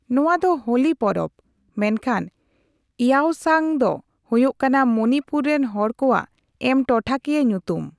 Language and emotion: Santali, neutral